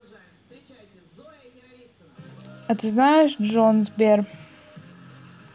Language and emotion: Russian, neutral